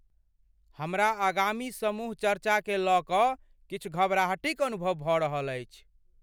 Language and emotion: Maithili, fearful